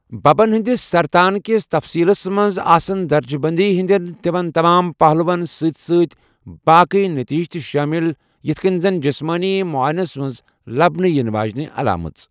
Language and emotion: Kashmiri, neutral